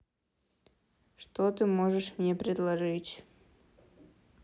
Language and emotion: Russian, neutral